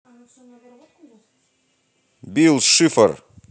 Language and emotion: Russian, positive